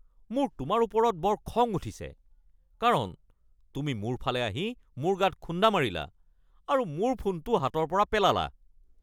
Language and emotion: Assamese, angry